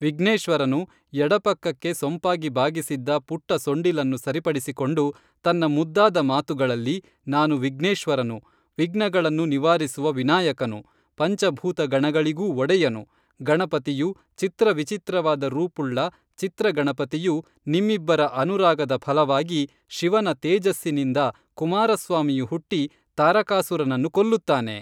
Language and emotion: Kannada, neutral